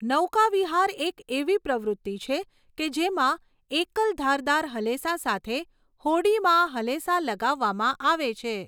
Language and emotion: Gujarati, neutral